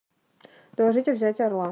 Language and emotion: Russian, neutral